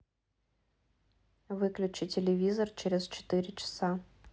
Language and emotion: Russian, neutral